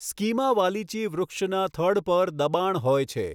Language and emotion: Gujarati, neutral